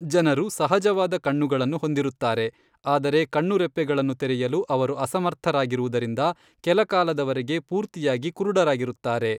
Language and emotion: Kannada, neutral